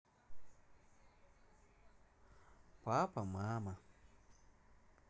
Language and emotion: Russian, neutral